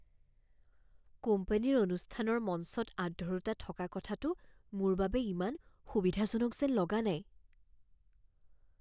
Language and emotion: Assamese, fearful